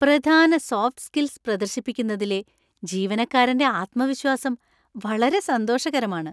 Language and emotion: Malayalam, happy